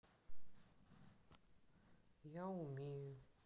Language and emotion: Russian, sad